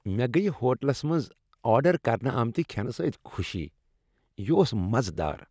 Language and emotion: Kashmiri, happy